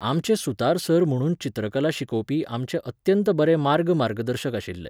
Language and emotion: Goan Konkani, neutral